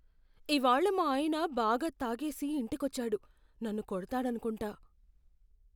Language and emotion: Telugu, fearful